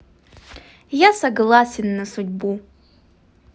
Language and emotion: Russian, positive